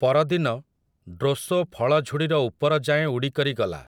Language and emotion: Odia, neutral